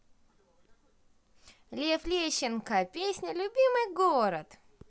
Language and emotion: Russian, positive